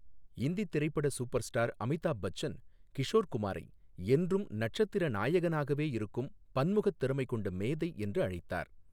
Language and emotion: Tamil, neutral